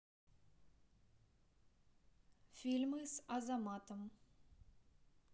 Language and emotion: Russian, neutral